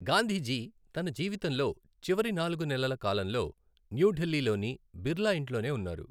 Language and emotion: Telugu, neutral